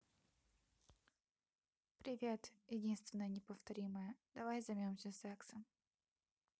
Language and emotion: Russian, neutral